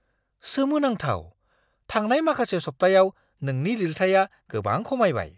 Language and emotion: Bodo, surprised